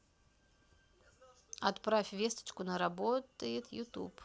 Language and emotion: Russian, neutral